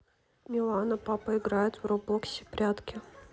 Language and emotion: Russian, neutral